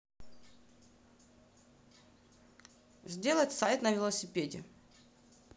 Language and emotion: Russian, neutral